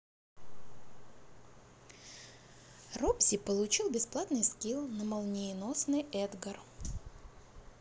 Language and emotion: Russian, positive